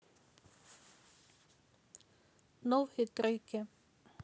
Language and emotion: Russian, neutral